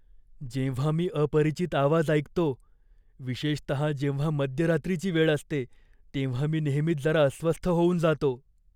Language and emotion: Marathi, fearful